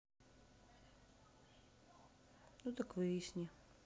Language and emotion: Russian, sad